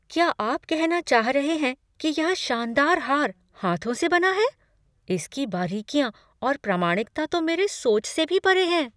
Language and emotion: Hindi, surprised